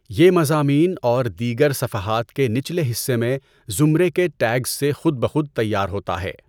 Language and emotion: Urdu, neutral